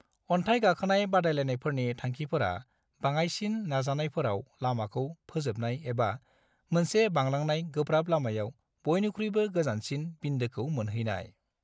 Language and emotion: Bodo, neutral